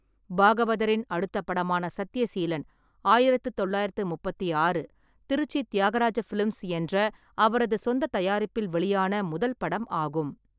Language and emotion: Tamil, neutral